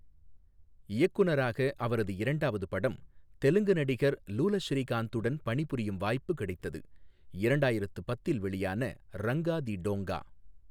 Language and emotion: Tamil, neutral